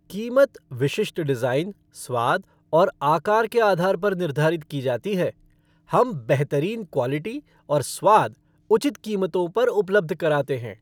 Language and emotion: Hindi, happy